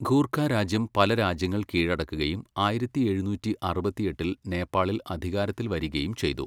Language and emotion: Malayalam, neutral